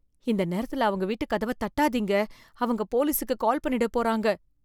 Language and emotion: Tamil, fearful